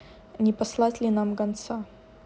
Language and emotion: Russian, neutral